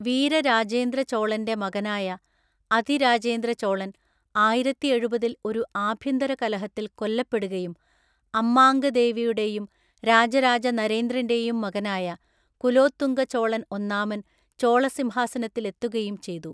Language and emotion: Malayalam, neutral